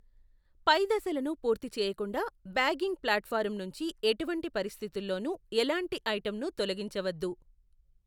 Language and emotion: Telugu, neutral